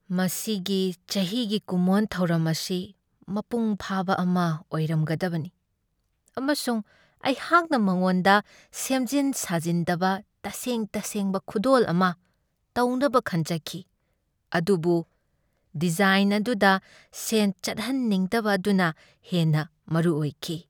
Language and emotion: Manipuri, sad